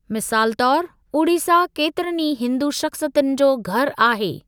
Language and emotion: Sindhi, neutral